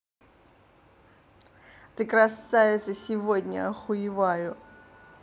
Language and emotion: Russian, positive